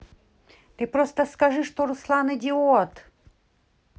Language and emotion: Russian, neutral